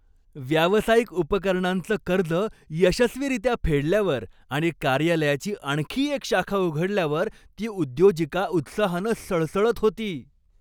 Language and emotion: Marathi, happy